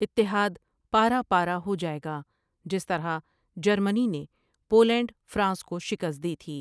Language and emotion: Urdu, neutral